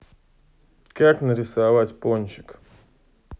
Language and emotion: Russian, neutral